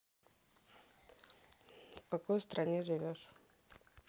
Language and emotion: Russian, neutral